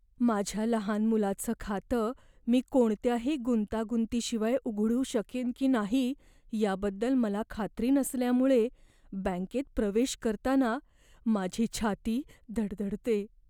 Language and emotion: Marathi, fearful